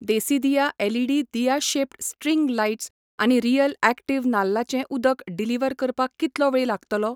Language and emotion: Goan Konkani, neutral